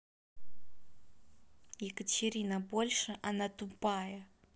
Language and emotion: Russian, angry